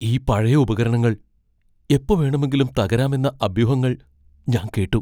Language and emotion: Malayalam, fearful